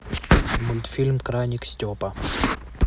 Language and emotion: Russian, neutral